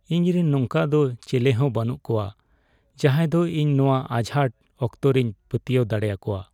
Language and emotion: Santali, sad